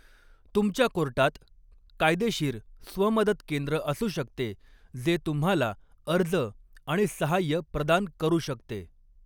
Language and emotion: Marathi, neutral